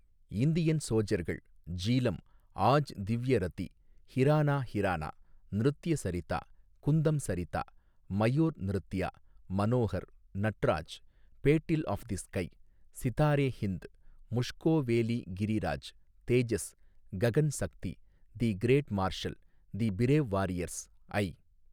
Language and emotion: Tamil, neutral